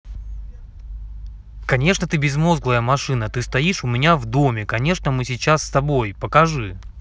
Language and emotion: Russian, angry